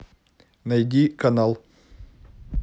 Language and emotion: Russian, neutral